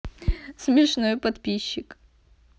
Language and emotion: Russian, positive